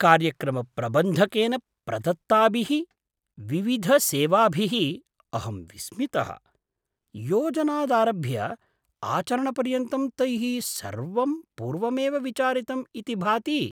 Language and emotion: Sanskrit, surprised